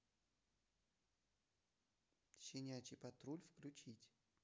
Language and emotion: Russian, neutral